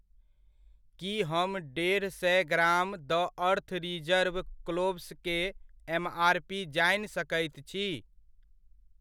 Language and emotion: Maithili, neutral